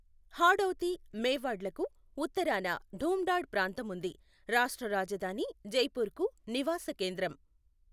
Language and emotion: Telugu, neutral